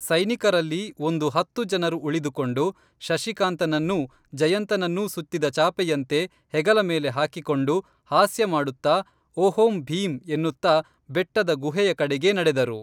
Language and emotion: Kannada, neutral